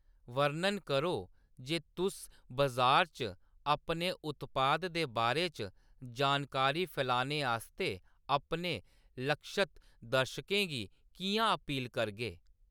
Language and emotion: Dogri, neutral